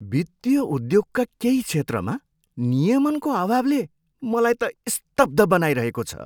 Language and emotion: Nepali, surprised